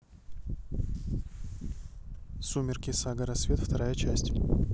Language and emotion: Russian, neutral